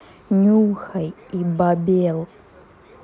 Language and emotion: Russian, angry